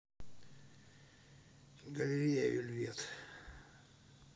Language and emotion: Russian, neutral